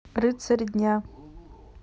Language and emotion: Russian, neutral